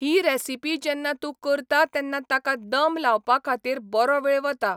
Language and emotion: Goan Konkani, neutral